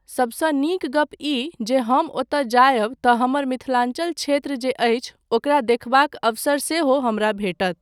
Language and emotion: Maithili, neutral